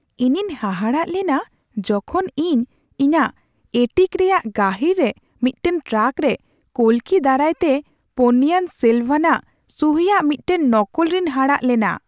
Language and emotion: Santali, surprised